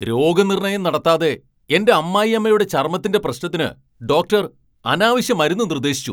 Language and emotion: Malayalam, angry